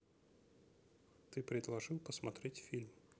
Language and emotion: Russian, neutral